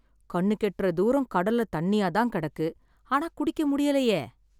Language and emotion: Tamil, sad